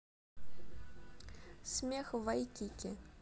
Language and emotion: Russian, neutral